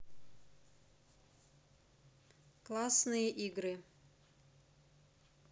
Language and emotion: Russian, neutral